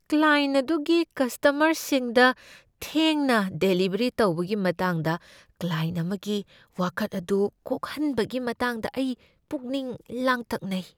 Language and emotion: Manipuri, fearful